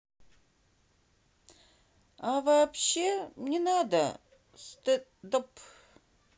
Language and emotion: Russian, neutral